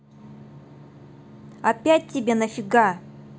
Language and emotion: Russian, angry